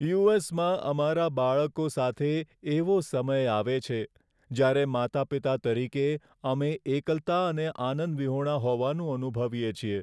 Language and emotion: Gujarati, sad